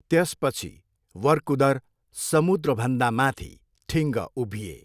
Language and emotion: Nepali, neutral